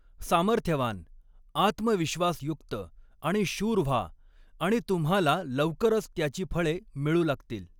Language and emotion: Marathi, neutral